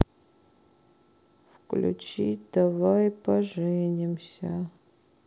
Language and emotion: Russian, sad